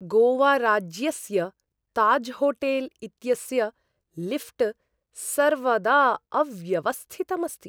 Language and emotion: Sanskrit, disgusted